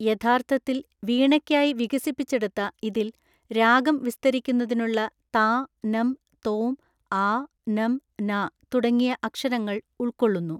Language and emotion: Malayalam, neutral